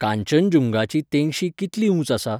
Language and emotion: Goan Konkani, neutral